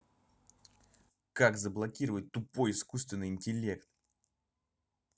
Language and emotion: Russian, angry